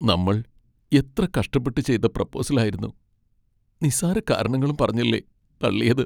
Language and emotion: Malayalam, sad